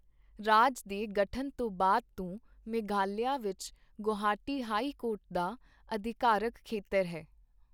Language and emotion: Punjabi, neutral